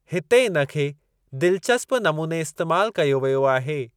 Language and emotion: Sindhi, neutral